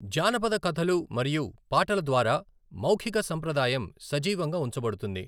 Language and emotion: Telugu, neutral